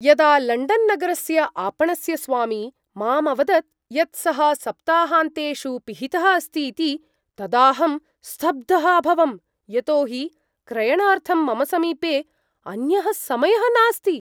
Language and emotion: Sanskrit, surprised